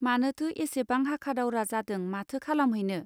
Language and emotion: Bodo, neutral